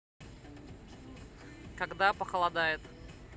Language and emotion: Russian, neutral